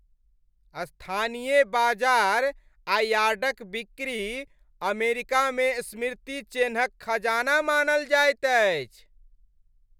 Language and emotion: Maithili, happy